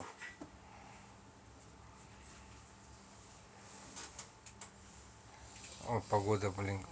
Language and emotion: Russian, neutral